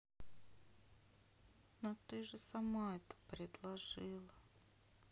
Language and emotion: Russian, sad